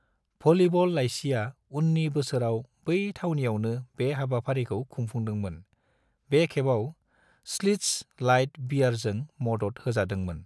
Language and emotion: Bodo, neutral